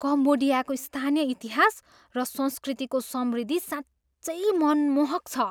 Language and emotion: Nepali, surprised